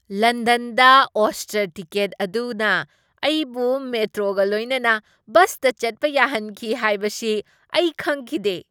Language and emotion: Manipuri, surprised